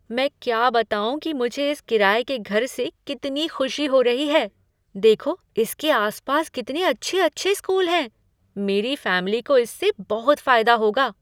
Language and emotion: Hindi, surprised